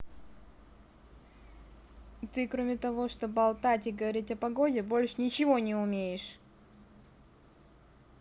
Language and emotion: Russian, angry